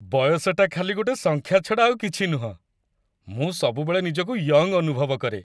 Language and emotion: Odia, happy